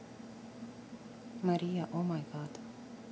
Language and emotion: Russian, neutral